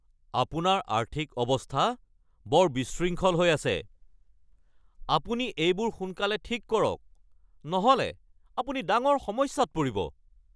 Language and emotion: Assamese, angry